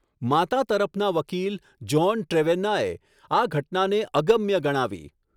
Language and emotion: Gujarati, neutral